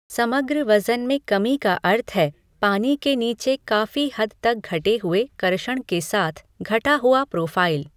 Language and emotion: Hindi, neutral